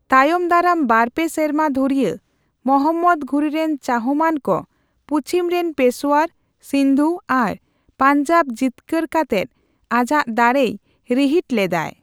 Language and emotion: Santali, neutral